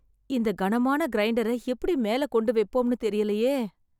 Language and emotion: Tamil, sad